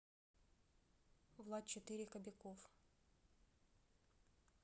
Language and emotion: Russian, neutral